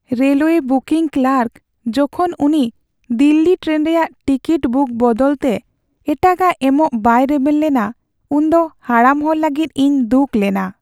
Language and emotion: Santali, sad